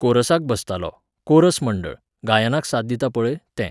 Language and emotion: Goan Konkani, neutral